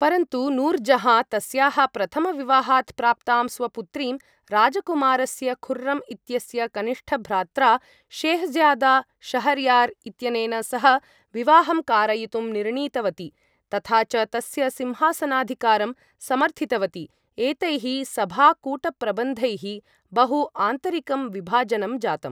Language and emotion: Sanskrit, neutral